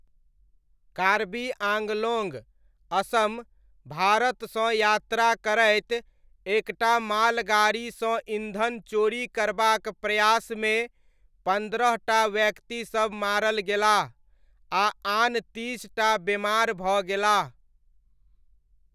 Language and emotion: Maithili, neutral